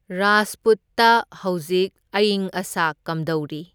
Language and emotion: Manipuri, neutral